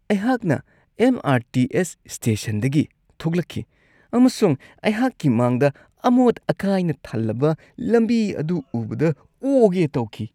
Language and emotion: Manipuri, disgusted